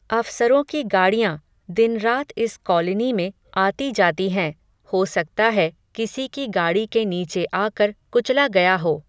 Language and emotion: Hindi, neutral